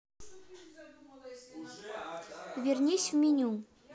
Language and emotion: Russian, neutral